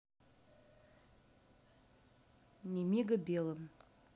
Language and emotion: Russian, neutral